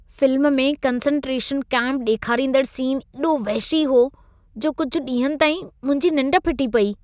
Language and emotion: Sindhi, disgusted